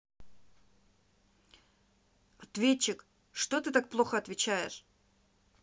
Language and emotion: Russian, angry